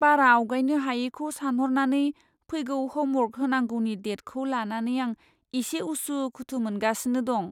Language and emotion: Bodo, fearful